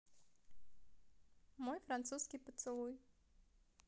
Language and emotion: Russian, positive